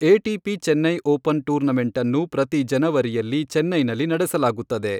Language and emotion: Kannada, neutral